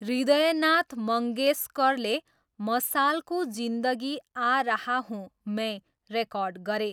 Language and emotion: Nepali, neutral